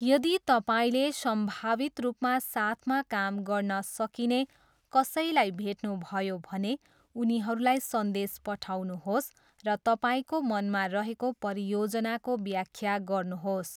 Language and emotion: Nepali, neutral